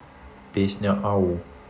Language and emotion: Russian, neutral